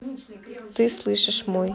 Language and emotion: Russian, neutral